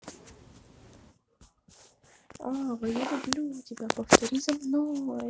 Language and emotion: Russian, positive